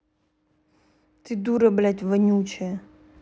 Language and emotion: Russian, angry